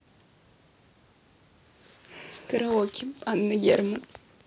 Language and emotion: Russian, positive